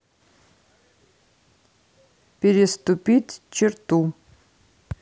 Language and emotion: Russian, neutral